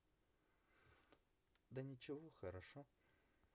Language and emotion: Russian, neutral